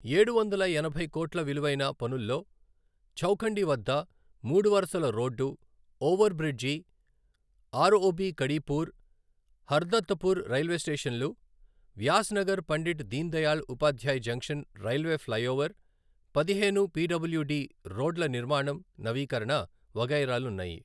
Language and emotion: Telugu, neutral